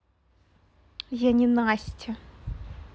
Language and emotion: Russian, angry